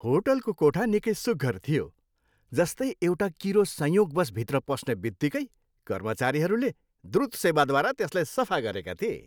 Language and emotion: Nepali, happy